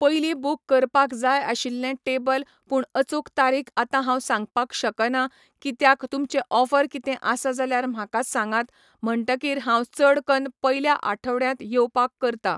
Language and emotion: Goan Konkani, neutral